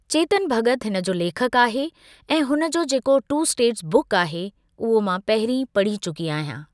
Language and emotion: Sindhi, neutral